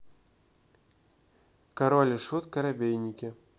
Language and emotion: Russian, neutral